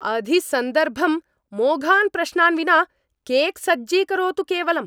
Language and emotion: Sanskrit, angry